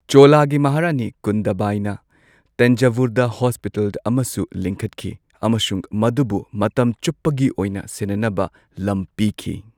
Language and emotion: Manipuri, neutral